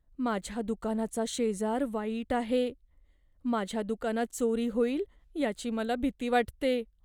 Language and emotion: Marathi, fearful